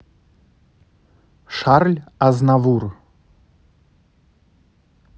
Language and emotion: Russian, neutral